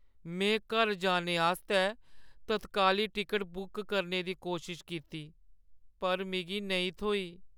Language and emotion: Dogri, sad